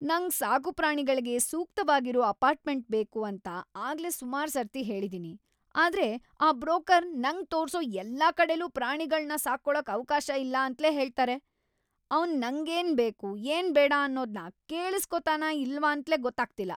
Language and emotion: Kannada, angry